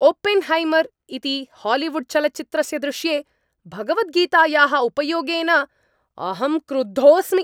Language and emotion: Sanskrit, angry